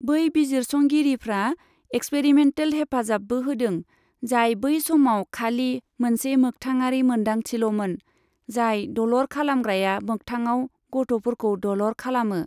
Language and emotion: Bodo, neutral